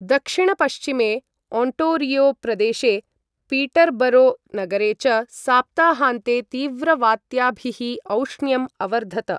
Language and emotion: Sanskrit, neutral